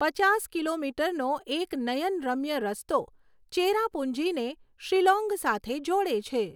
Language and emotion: Gujarati, neutral